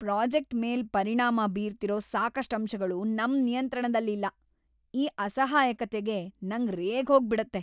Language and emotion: Kannada, angry